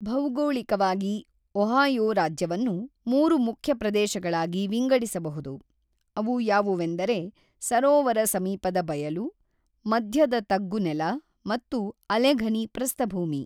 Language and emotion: Kannada, neutral